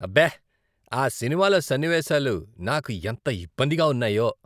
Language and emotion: Telugu, disgusted